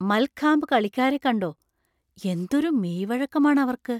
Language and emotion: Malayalam, surprised